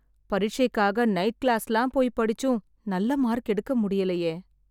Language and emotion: Tamil, sad